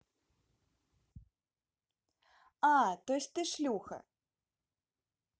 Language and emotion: Russian, neutral